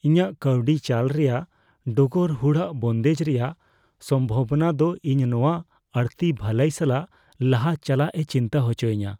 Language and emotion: Santali, fearful